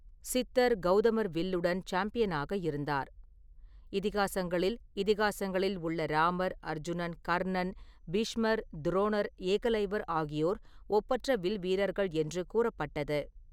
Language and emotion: Tamil, neutral